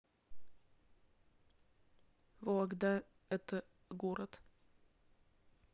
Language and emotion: Russian, neutral